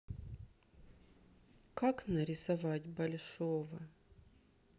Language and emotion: Russian, sad